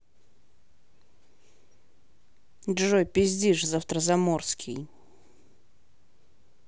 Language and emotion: Russian, angry